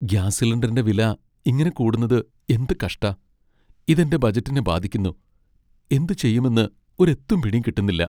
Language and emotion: Malayalam, sad